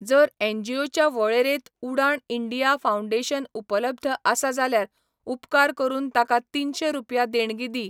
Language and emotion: Goan Konkani, neutral